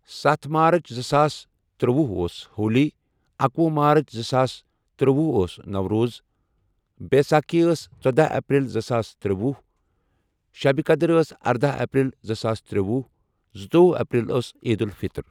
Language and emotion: Kashmiri, neutral